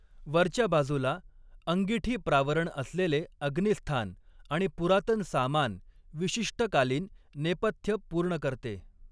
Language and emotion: Marathi, neutral